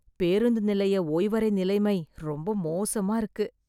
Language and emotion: Tamil, disgusted